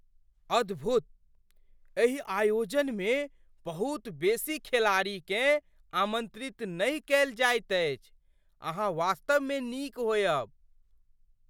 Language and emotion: Maithili, surprised